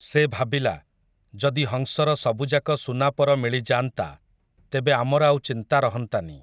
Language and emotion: Odia, neutral